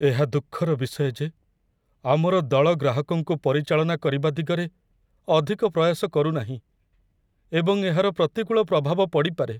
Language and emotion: Odia, sad